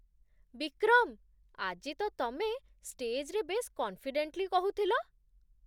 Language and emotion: Odia, surprised